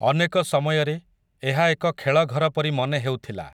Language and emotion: Odia, neutral